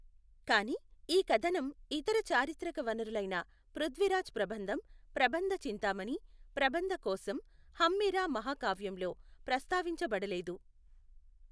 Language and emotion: Telugu, neutral